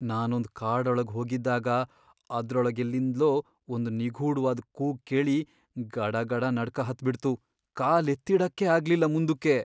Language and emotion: Kannada, fearful